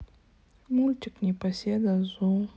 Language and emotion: Russian, sad